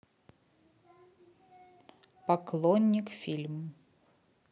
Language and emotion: Russian, neutral